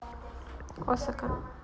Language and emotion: Russian, neutral